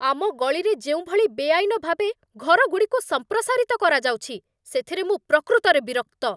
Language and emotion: Odia, angry